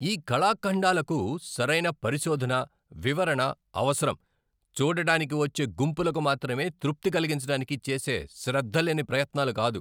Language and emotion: Telugu, angry